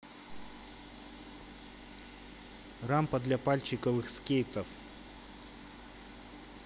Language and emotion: Russian, neutral